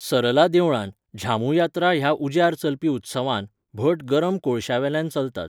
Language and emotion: Goan Konkani, neutral